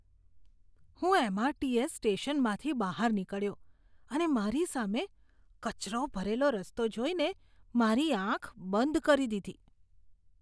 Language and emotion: Gujarati, disgusted